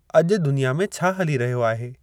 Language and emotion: Sindhi, neutral